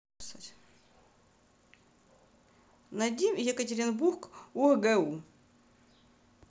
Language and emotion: Russian, neutral